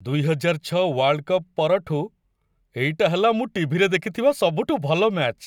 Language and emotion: Odia, happy